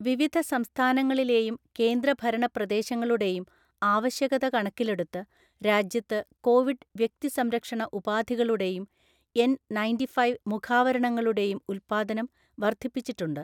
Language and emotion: Malayalam, neutral